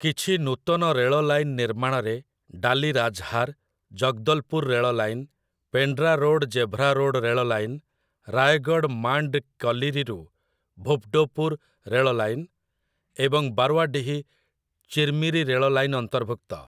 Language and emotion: Odia, neutral